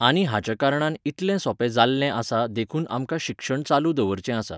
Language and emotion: Goan Konkani, neutral